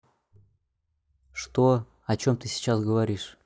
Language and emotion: Russian, neutral